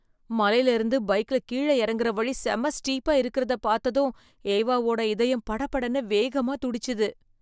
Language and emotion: Tamil, fearful